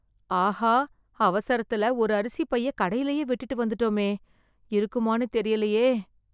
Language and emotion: Tamil, fearful